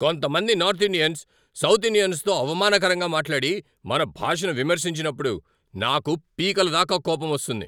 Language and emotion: Telugu, angry